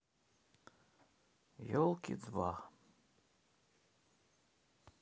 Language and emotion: Russian, neutral